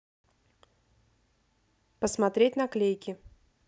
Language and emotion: Russian, neutral